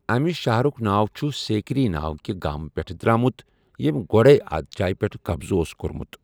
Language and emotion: Kashmiri, neutral